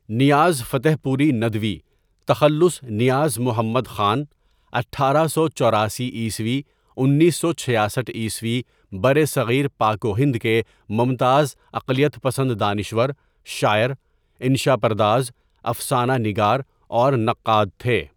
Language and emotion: Urdu, neutral